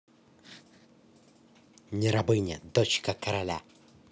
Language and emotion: Russian, positive